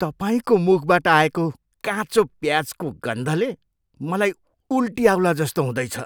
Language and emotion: Nepali, disgusted